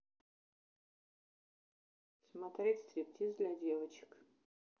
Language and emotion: Russian, neutral